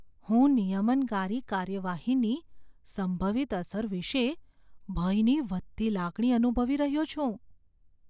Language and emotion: Gujarati, fearful